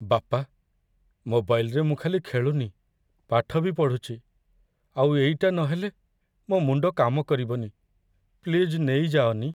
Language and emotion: Odia, sad